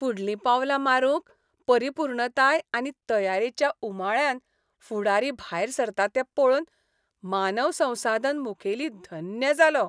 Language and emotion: Goan Konkani, happy